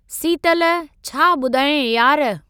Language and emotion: Sindhi, neutral